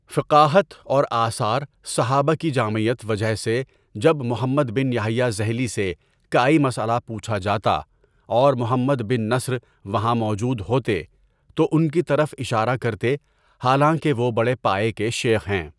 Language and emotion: Urdu, neutral